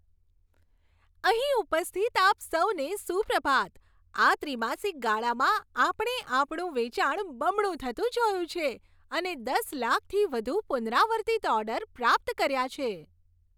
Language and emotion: Gujarati, happy